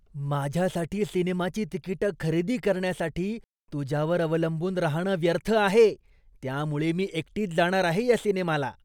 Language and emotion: Marathi, disgusted